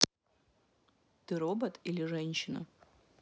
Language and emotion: Russian, neutral